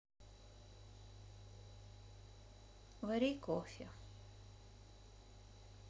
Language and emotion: Russian, sad